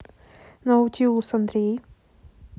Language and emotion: Russian, neutral